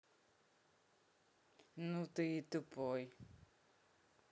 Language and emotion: Russian, angry